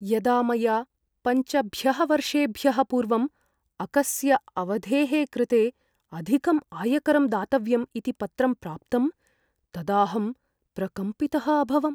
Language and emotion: Sanskrit, fearful